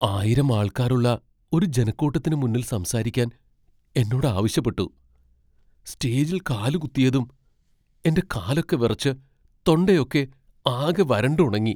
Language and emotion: Malayalam, fearful